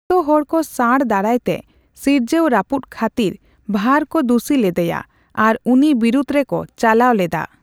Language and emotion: Santali, neutral